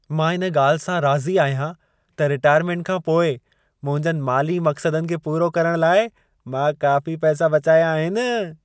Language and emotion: Sindhi, happy